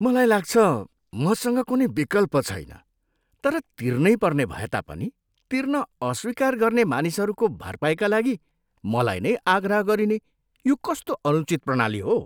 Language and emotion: Nepali, disgusted